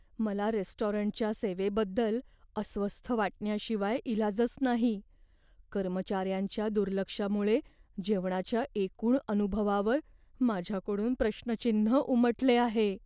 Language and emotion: Marathi, fearful